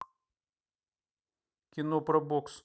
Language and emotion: Russian, neutral